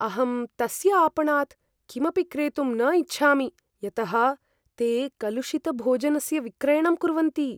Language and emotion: Sanskrit, fearful